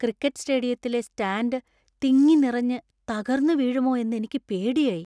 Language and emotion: Malayalam, fearful